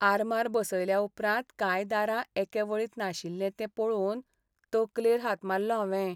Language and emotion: Goan Konkani, sad